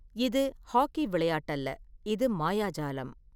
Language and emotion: Tamil, neutral